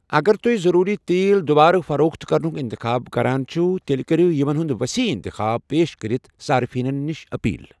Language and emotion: Kashmiri, neutral